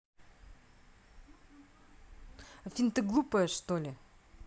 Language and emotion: Russian, angry